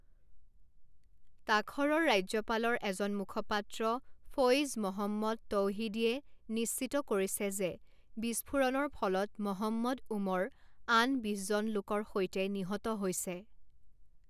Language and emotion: Assamese, neutral